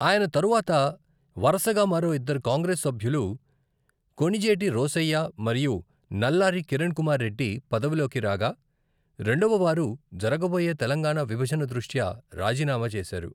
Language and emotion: Telugu, neutral